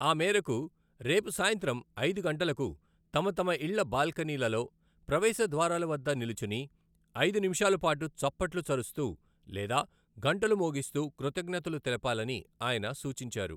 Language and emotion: Telugu, neutral